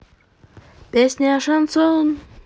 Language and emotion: Russian, positive